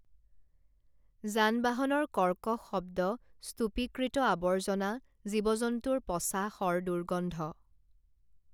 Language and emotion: Assamese, neutral